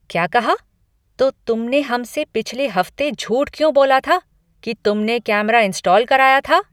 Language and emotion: Hindi, angry